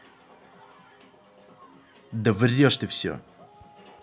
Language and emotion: Russian, angry